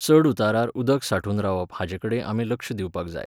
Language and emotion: Goan Konkani, neutral